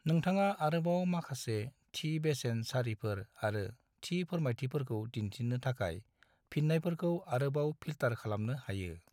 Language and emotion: Bodo, neutral